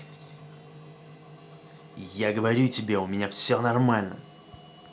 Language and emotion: Russian, angry